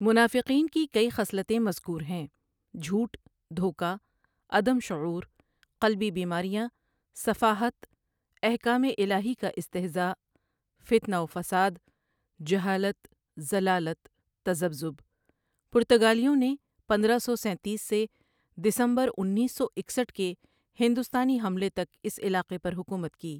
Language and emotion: Urdu, neutral